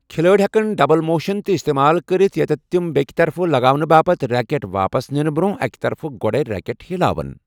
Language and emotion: Kashmiri, neutral